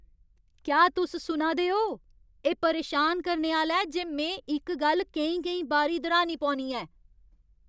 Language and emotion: Dogri, angry